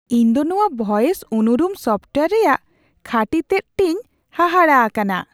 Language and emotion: Santali, surprised